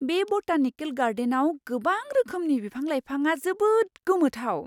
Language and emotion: Bodo, surprised